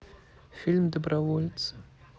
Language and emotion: Russian, sad